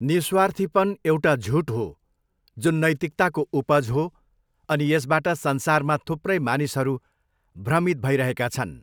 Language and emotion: Nepali, neutral